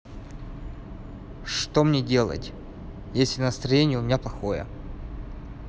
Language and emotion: Russian, neutral